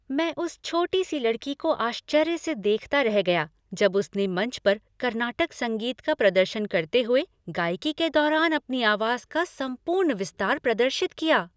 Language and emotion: Hindi, happy